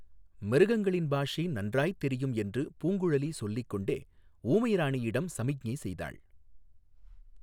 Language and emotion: Tamil, neutral